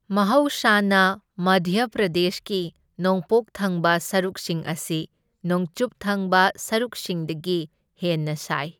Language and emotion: Manipuri, neutral